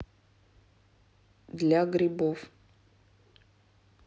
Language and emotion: Russian, neutral